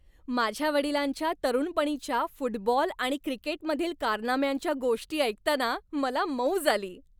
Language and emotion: Marathi, happy